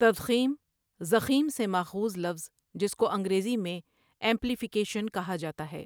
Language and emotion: Urdu, neutral